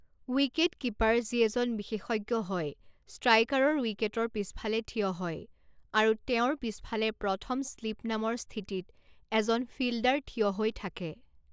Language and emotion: Assamese, neutral